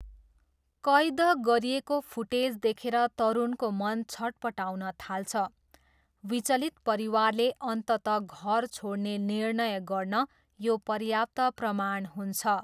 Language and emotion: Nepali, neutral